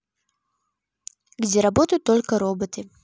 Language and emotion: Russian, neutral